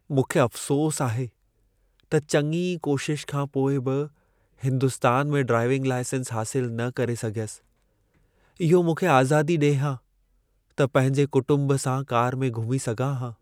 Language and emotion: Sindhi, sad